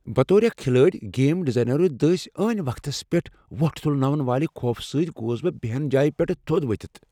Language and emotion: Kashmiri, fearful